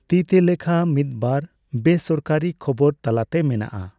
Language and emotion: Santali, neutral